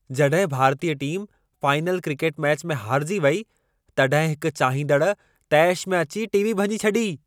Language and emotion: Sindhi, angry